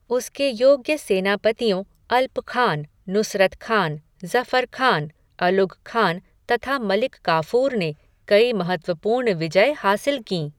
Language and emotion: Hindi, neutral